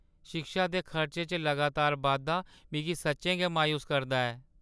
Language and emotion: Dogri, sad